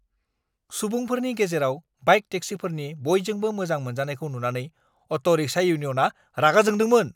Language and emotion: Bodo, angry